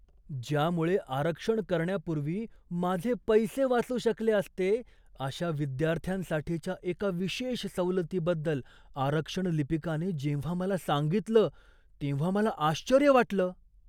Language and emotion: Marathi, surprised